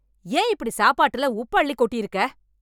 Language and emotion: Tamil, angry